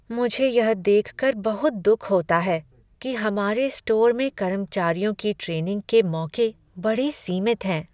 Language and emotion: Hindi, sad